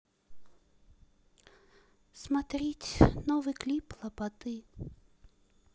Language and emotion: Russian, sad